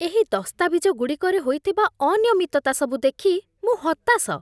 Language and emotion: Odia, disgusted